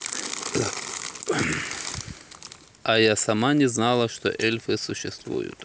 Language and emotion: Russian, neutral